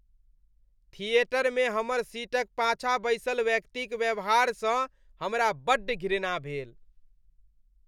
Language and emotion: Maithili, disgusted